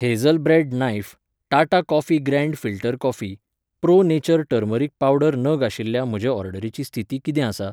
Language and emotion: Goan Konkani, neutral